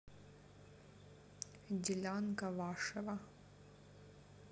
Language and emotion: Russian, neutral